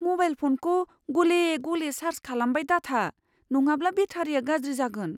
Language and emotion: Bodo, fearful